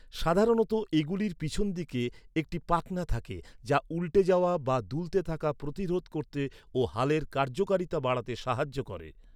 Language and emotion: Bengali, neutral